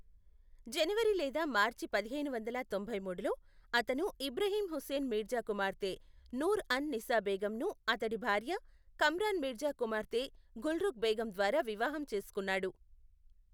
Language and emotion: Telugu, neutral